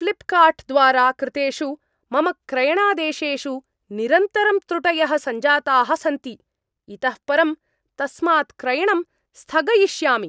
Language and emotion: Sanskrit, angry